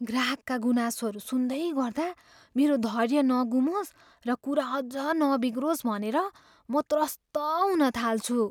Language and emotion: Nepali, fearful